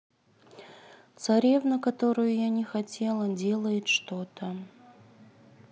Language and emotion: Russian, neutral